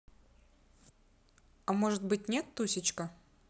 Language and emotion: Russian, positive